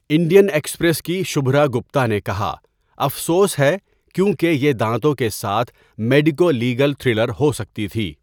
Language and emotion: Urdu, neutral